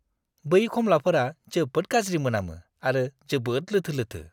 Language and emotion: Bodo, disgusted